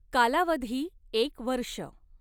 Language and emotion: Marathi, neutral